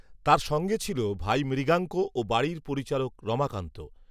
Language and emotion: Bengali, neutral